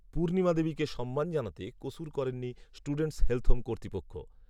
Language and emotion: Bengali, neutral